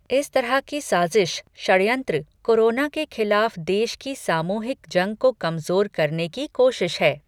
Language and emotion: Hindi, neutral